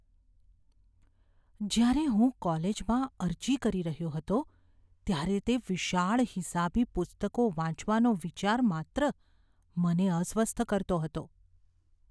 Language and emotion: Gujarati, fearful